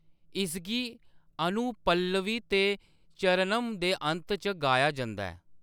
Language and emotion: Dogri, neutral